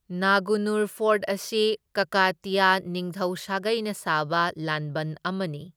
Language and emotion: Manipuri, neutral